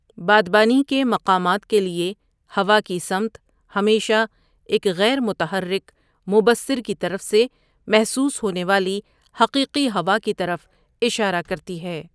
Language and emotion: Urdu, neutral